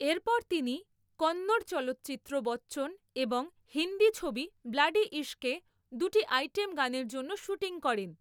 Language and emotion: Bengali, neutral